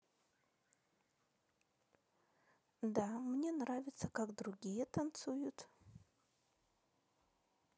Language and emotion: Russian, neutral